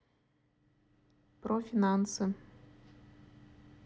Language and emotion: Russian, neutral